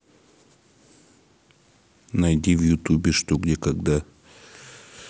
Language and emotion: Russian, neutral